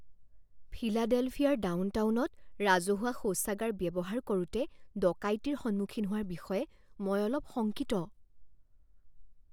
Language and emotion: Assamese, fearful